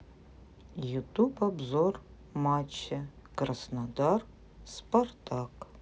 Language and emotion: Russian, neutral